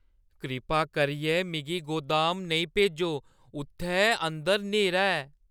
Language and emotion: Dogri, fearful